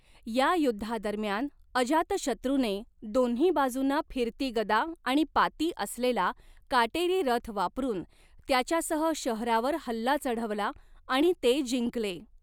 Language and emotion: Marathi, neutral